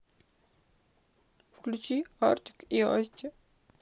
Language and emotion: Russian, sad